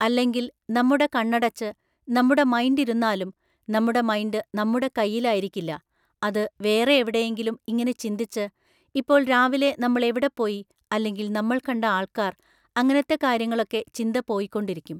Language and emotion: Malayalam, neutral